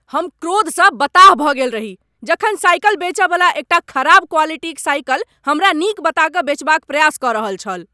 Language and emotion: Maithili, angry